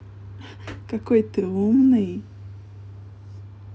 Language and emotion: Russian, positive